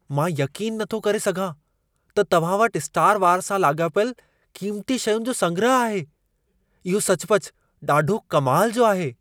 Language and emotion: Sindhi, surprised